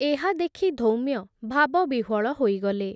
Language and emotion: Odia, neutral